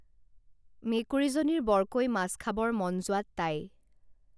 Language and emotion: Assamese, neutral